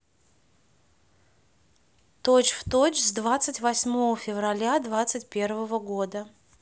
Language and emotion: Russian, neutral